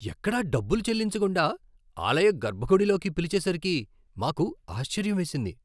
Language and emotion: Telugu, surprised